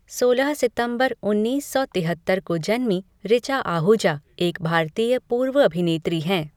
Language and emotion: Hindi, neutral